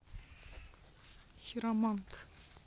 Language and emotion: Russian, neutral